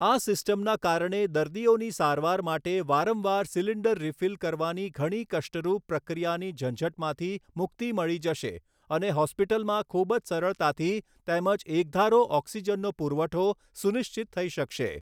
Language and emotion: Gujarati, neutral